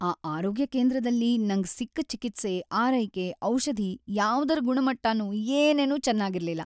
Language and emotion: Kannada, sad